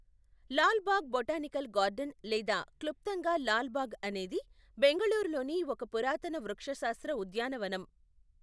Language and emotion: Telugu, neutral